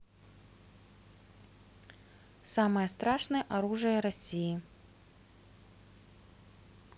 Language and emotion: Russian, neutral